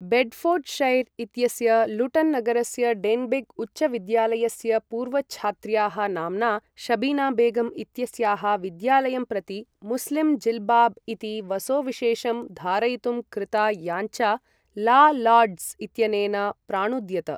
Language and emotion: Sanskrit, neutral